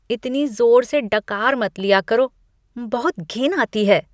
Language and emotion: Hindi, disgusted